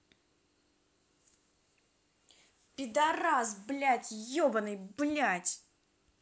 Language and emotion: Russian, angry